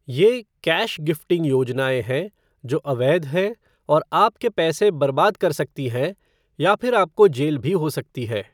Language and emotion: Hindi, neutral